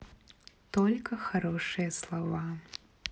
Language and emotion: Russian, neutral